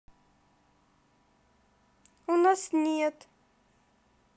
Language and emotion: Russian, sad